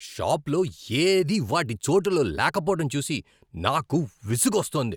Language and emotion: Telugu, angry